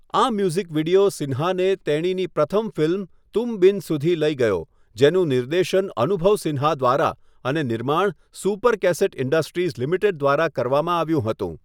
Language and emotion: Gujarati, neutral